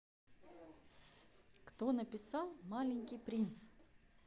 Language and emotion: Russian, neutral